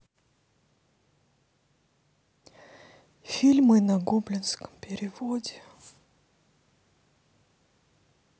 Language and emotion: Russian, sad